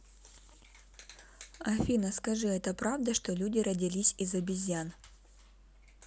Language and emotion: Russian, neutral